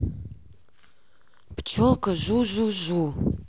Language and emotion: Russian, angry